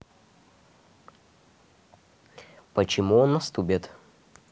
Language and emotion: Russian, neutral